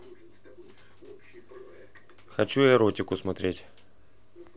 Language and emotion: Russian, neutral